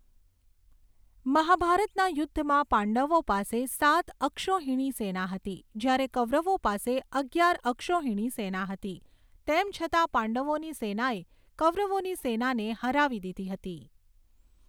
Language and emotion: Gujarati, neutral